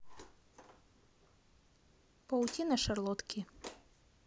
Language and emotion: Russian, neutral